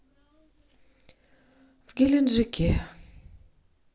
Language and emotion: Russian, sad